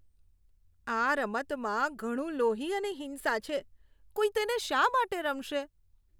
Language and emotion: Gujarati, disgusted